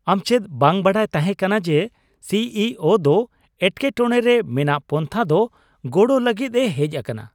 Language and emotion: Santali, surprised